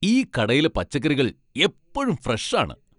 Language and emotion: Malayalam, happy